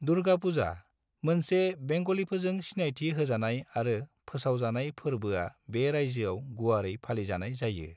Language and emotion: Bodo, neutral